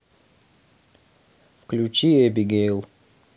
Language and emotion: Russian, neutral